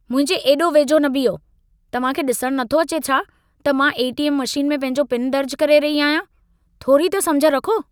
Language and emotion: Sindhi, angry